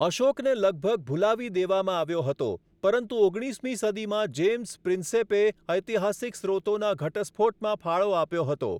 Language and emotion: Gujarati, neutral